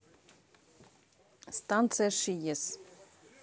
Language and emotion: Russian, neutral